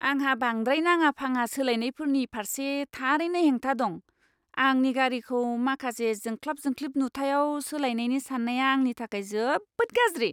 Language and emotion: Bodo, disgusted